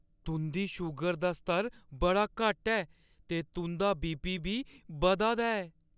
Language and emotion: Dogri, fearful